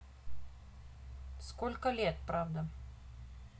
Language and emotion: Russian, neutral